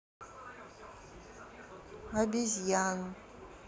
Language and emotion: Russian, neutral